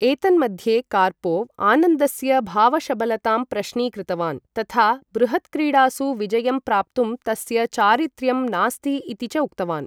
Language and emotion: Sanskrit, neutral